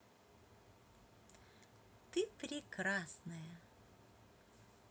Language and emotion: Russian, positive